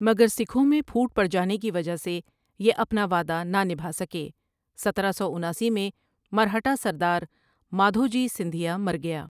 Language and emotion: Urdu, neutral